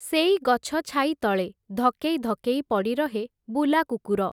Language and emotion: Odia, neutral